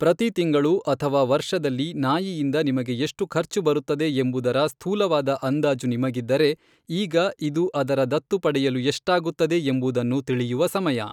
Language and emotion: Kannada, neutral